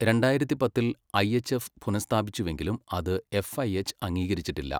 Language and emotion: Malayalam, neutral